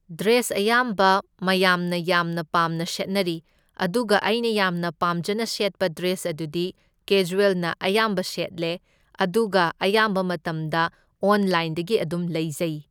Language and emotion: Manipuri, neutral